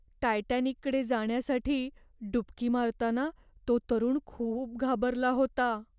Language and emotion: Marathi, fearful